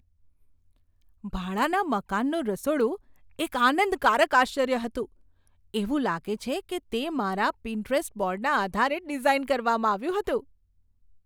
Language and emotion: Gujarati, surprised